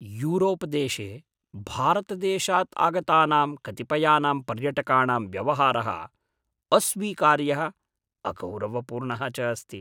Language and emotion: Sanskrit, disgusted